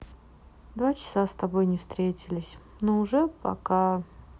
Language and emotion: Russian, sad